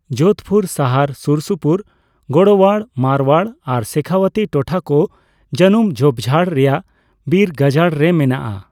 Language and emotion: Santali, neutral